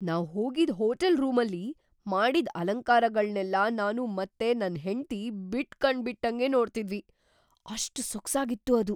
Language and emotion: Kannada, surprised